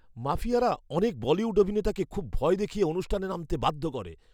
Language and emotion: Bengali, fearful